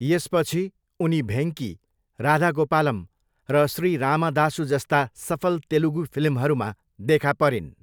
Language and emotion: Nepali, neutral